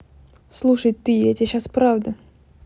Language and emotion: Russian, angry